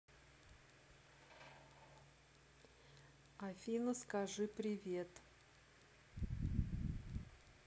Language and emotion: Russian, neutral